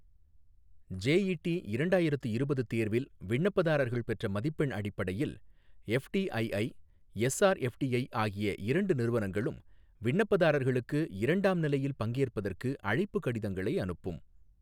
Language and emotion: Tamil, neutral